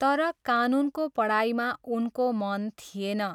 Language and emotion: Nepali, neutral